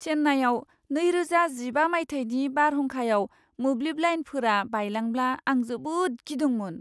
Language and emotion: Bodo, fearful